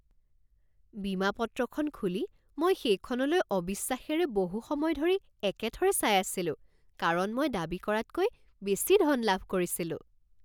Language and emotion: Assamese, surprised